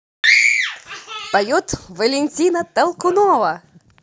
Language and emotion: Russian, positive